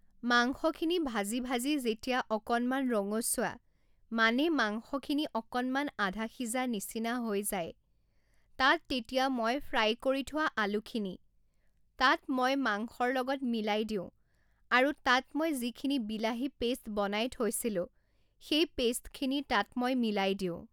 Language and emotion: Assamese, neutral